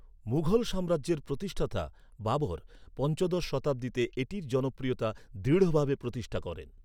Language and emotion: Bengali, neutral